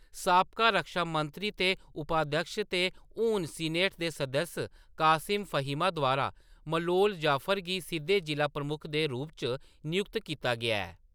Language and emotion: Dogri, neutral